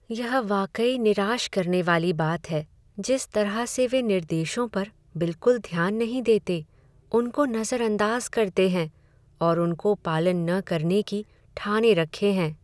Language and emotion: Hindi, sad